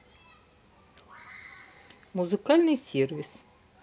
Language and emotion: Russian, neutral